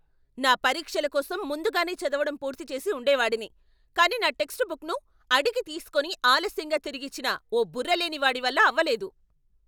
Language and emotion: Telugu, angry